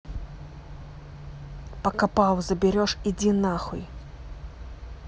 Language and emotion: Russian, angry